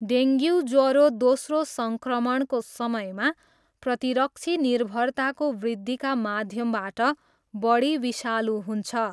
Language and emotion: Nepali, neutral